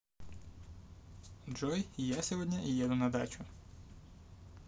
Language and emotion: Russian, positive